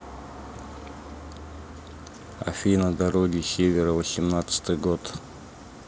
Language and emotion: Russian, neutral